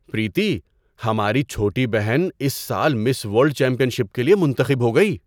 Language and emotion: Urdu, surprised